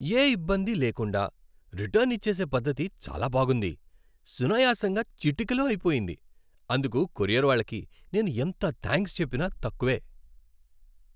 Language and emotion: Telugu, happy